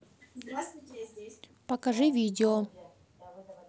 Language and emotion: Russian, neutral